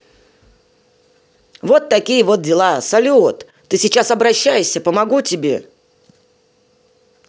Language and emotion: Russian, positive